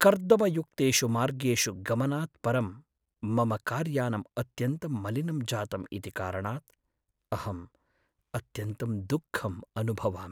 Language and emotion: Sanskrit, sad